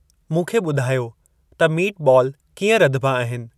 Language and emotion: Sindhi, neutral